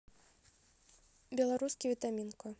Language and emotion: Russian, neutral